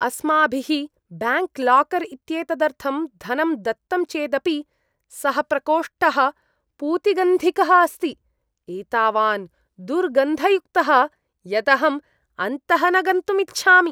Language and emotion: Sanskrit, disgusted